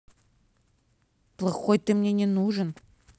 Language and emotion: Russian, angry